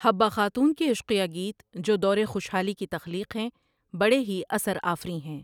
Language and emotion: Urdu, neutral